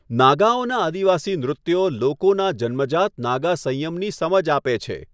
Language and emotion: Gujarati, neutral